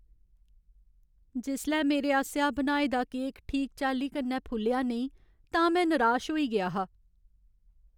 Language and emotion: Dogri, sad